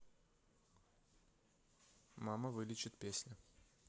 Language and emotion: Russian, neutral